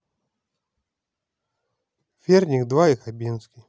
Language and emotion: Russian, neutral